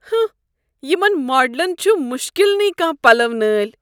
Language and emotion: Kashmiri, disgusted